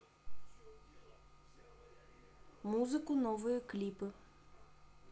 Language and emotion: Russian, neutral